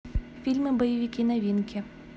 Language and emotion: Russian, neutral